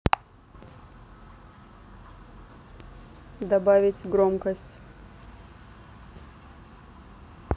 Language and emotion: Russian, neutral